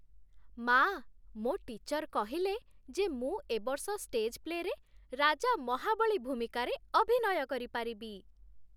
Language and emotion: Odia, happy